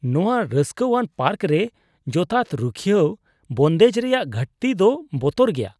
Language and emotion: Santali, disgusted